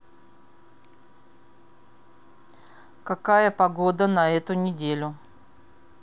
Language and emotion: Russian, neutral